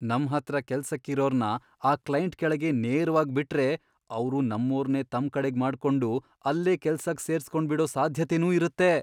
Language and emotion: Kannada, fearful